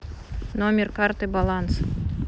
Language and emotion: Russian, neutral